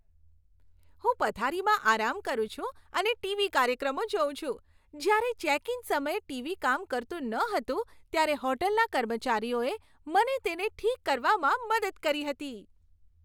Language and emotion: Gujarati, happy